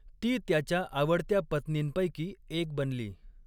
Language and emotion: Marathi, neutral